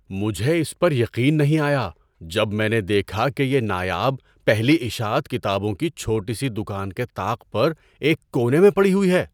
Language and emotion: Urdu, surprised